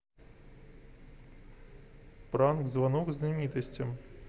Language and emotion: Russian, neutral